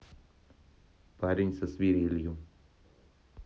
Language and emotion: Russian, neutral